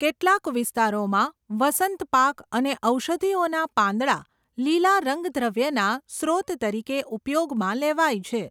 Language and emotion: Gujarati, neutral